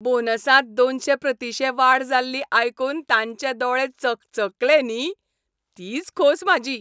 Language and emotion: Goan Konkani, happy